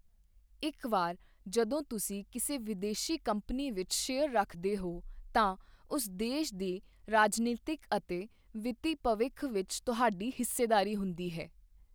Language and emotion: Punjabi, neutral